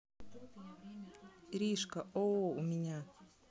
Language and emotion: Russian, neutral